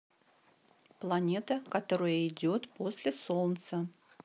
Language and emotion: Russian, neutral